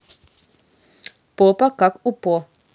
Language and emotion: Russian, neutral